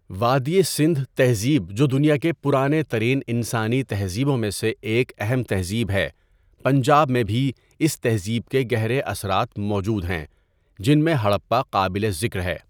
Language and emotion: Urdu, neutral